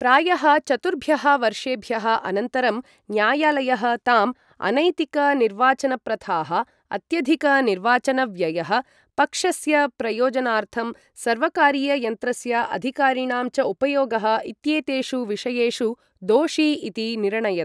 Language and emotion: Sanskrit, neutral